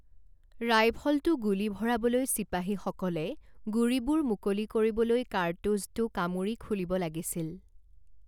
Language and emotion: Assamese, neutral